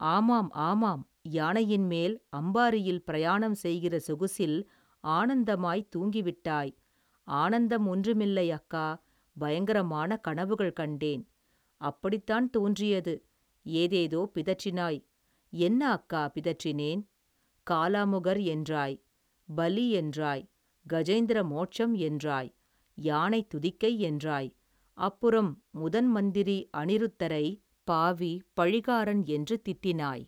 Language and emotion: Tamil, neutral